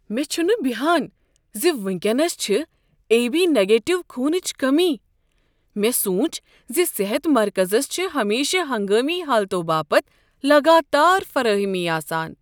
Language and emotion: Kashmiri, surprised